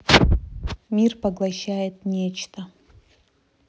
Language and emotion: Russian, neutral